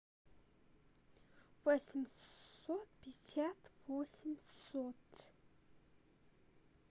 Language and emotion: Russian, neutral